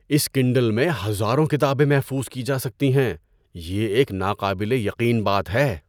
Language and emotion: Urdu, surprised